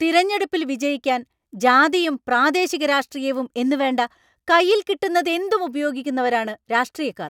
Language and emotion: Malayalam, angry